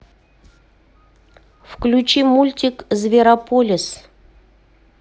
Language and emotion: Russian, neutral